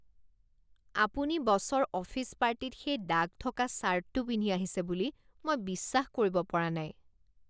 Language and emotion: Assamese, disgusted